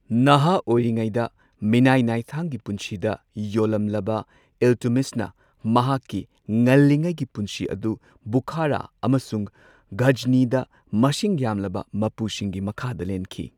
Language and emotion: Manipuri, neutral